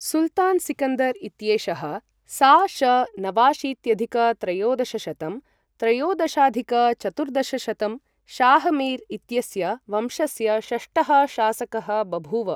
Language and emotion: Sanskrit, neutral